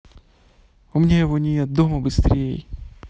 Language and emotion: Russian, neutral